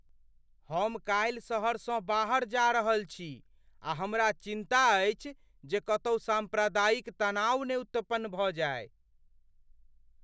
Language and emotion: Maithili, fearful